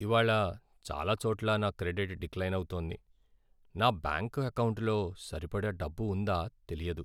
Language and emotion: Telugu, sad